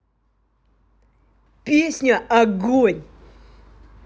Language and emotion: Russian, positive